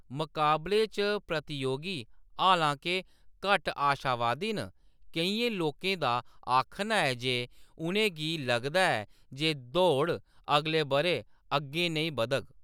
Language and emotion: Dogri, neutral